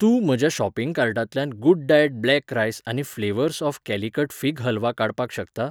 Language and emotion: Goan Konkani, neutral